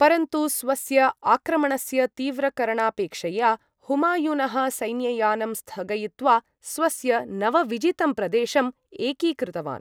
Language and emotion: Sanskrit, neutral